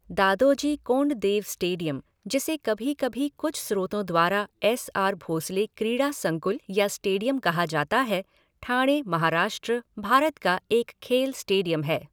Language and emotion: Hindi, neutral